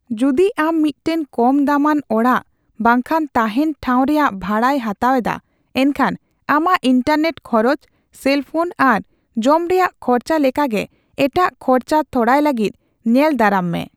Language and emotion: Santali, neutral